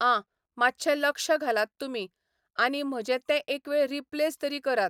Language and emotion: Goan Konkani, neutral